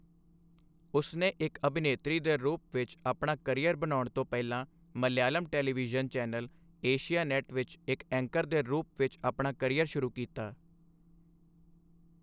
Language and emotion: Punjabi, neutral